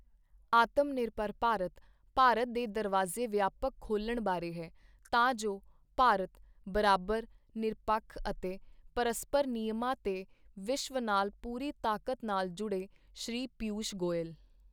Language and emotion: Punjabi, neutral